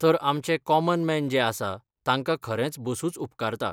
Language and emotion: Goan Konkani, neutral